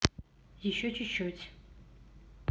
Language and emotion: Russian, neutral